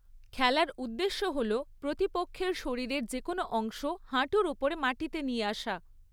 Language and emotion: Bengali, neutral